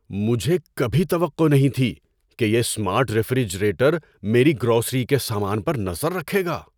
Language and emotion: Urdu, surprised